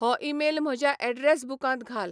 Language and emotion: Goan Konkani, neutral